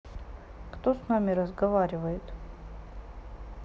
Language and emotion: Russian, sad